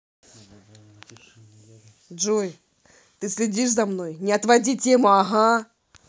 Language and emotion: Russian, angry